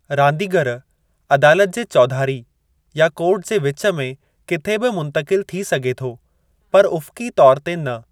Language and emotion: Sindhi, neutral